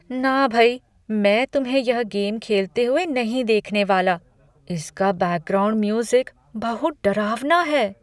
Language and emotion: Hindi, fearful